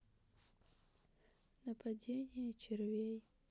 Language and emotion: Russian, sad